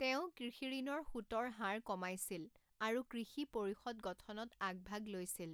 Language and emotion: Assamese, neutral